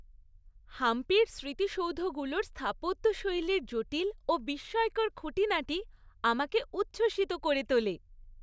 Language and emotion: Bengali, happy